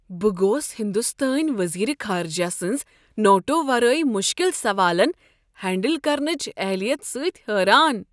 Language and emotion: Kashmiri, surprised